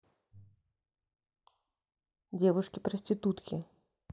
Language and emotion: Russian, neutral